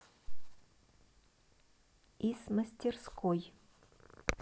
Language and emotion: Russian, neutral